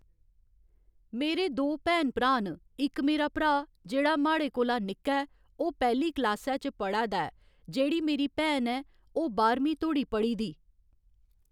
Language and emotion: Dogri, neutral